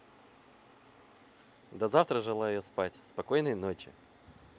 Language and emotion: Russian, positive